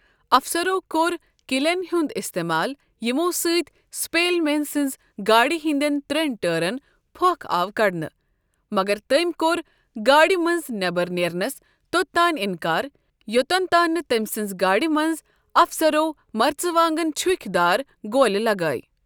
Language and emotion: Kashmiri, neutral